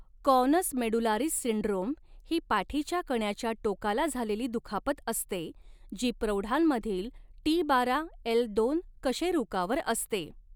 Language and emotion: Marathi, neutral